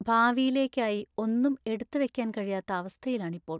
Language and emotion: Malayalam, sad